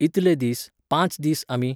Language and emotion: Goan Konkani, neutral